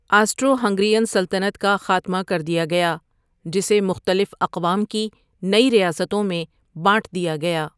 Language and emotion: Urdu, neutral